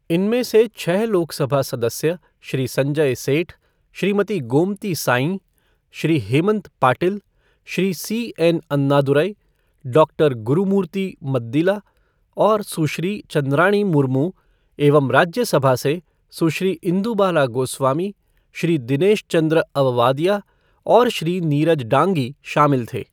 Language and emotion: Hindi, neutral